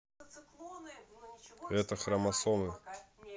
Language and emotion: Russian, neutral